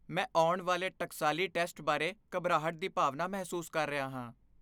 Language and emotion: Punjabi, fearful